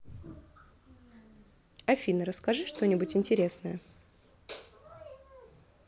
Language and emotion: Russian, neutral